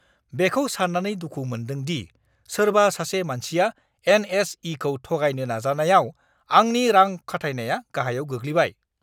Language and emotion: Bodo, angry